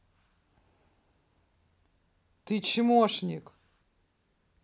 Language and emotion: Russian, angry